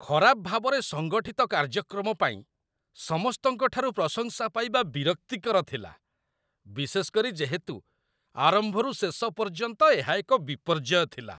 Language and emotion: Odia, disgusted